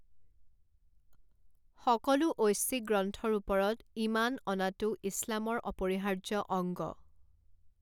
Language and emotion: Assamese, neutral